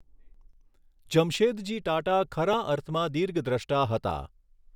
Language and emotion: Gujarati, neutral